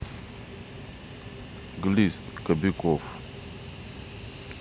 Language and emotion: Russian, neutral